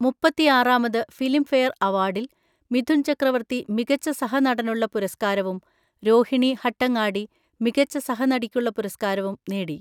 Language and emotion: Malayalam, neutral